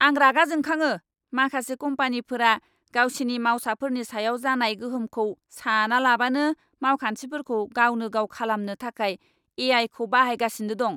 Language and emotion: Bodo, angry